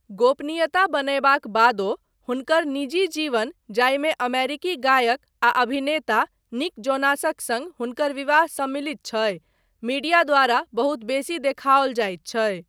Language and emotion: Maithili, neutral